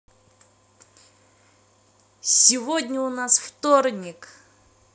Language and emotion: Russian, positive